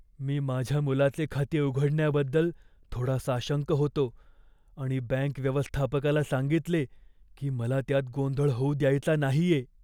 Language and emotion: Marathi, fearful